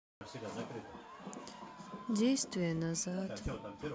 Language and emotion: Russian, sad